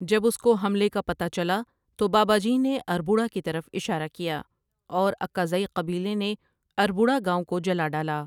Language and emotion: Urdu, neutral